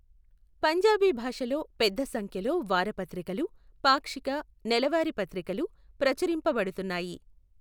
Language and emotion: Telugu, neutral